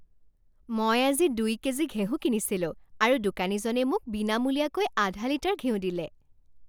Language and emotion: Assamese, happy